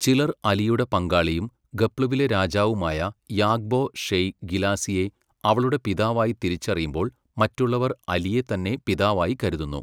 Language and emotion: Malayalam, neutral